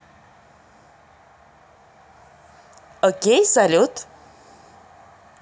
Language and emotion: Russian, positive